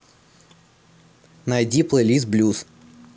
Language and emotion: Russian, neutral